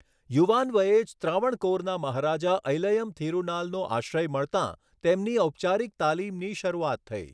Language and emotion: Gujarati, neutral